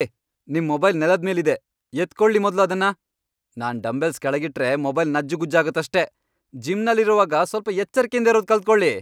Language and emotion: Kannada, angry